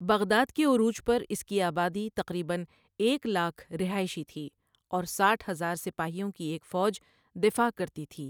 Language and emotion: Urdu, neutral